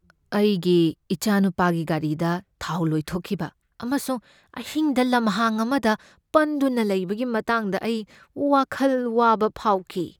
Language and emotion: Manipuri, fearful